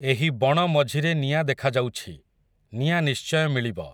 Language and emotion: Odia, neutral